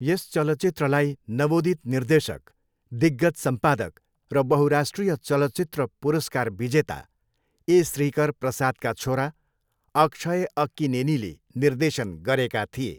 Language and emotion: Nepali, neutral